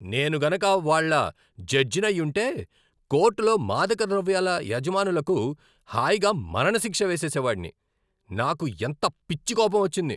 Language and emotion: Telugu, angry